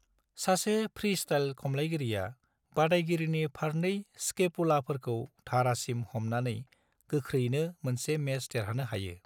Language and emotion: Bodo, neutral